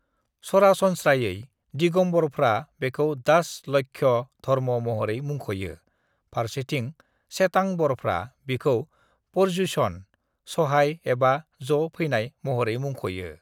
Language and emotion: Bodo, neutral